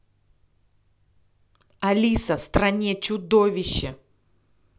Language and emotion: Russian, angry